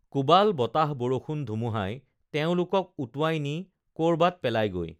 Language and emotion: Assamese, neutral